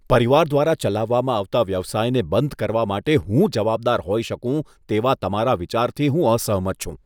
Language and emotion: Gujarati, disgusted